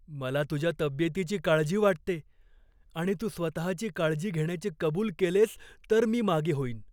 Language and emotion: Marathi, fearful